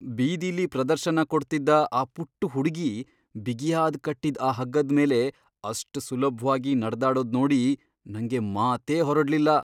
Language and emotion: Kannada, surprised